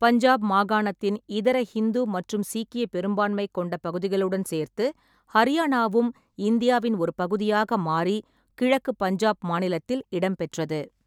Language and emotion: Tamil, neutral